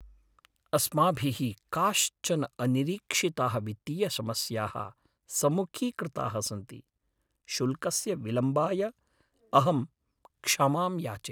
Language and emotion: Sanskrit, sad